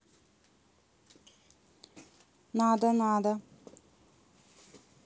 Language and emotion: Russian, neutral